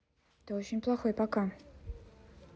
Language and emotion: Russian, neutral